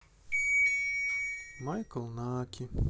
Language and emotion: Russian, sad